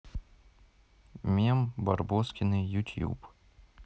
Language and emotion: Russian, neutral